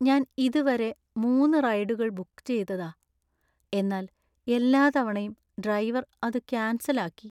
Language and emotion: Malayalam, sad